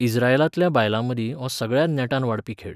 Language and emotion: Goan Konkani, neutral